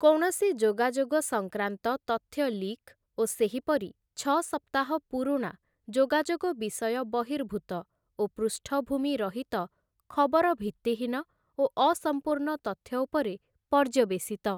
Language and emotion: Odia, neutral